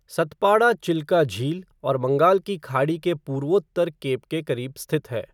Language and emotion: Hindi, neutral